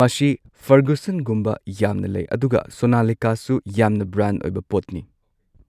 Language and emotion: Manipuri, neutral